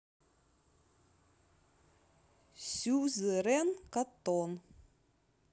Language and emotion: Russian, neutral